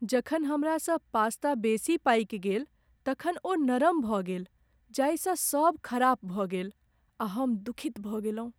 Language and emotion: Maithili, sad